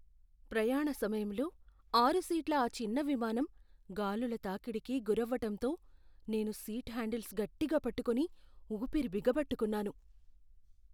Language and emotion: Telugu, fearful